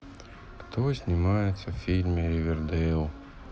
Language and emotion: Russian, sad